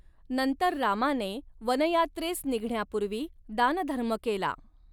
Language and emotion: Marathi, neutral